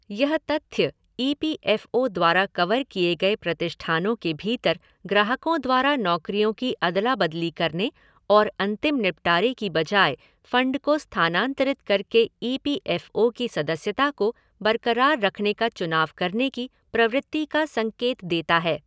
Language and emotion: Hindi, neutral